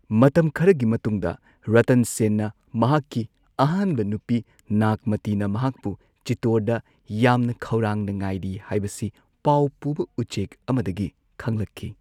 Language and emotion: Manipuri, neutral